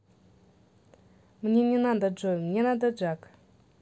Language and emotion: Russian, neutral